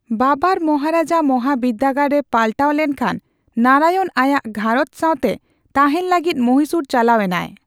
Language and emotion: Santali, neutral